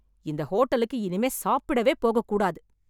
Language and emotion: Tamil, angry